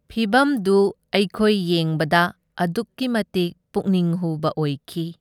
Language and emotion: Manipuri, neutral